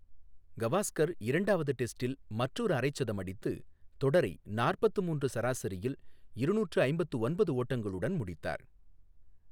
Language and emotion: Tamil, neutral